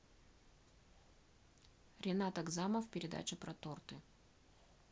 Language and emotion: Russian, neutral